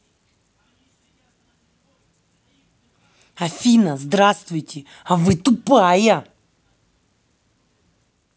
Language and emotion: Russian, angry